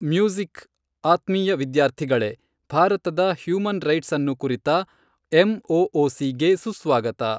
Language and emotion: Kannada, neutral